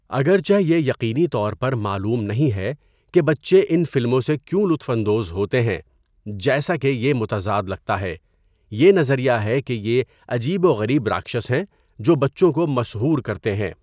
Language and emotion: Urdu, neutral